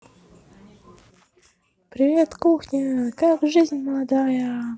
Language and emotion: Russian, positive